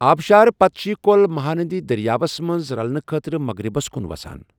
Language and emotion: Kashmiri, neutral